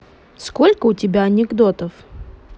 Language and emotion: Russian, neutral